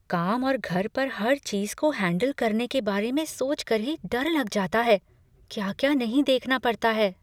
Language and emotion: Hindi, fearful